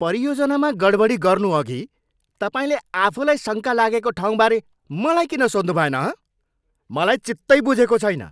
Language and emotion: Nepali, angry